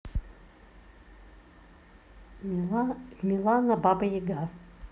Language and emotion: Russian, neutral